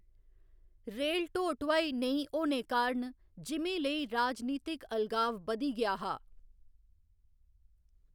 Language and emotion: Dogri, neutral